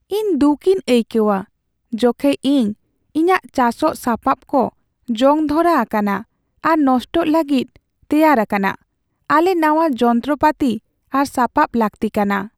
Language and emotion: Santali, sad